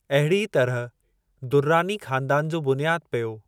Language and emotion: Sindhi, neutral